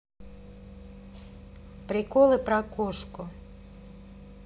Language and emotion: Russian, neutral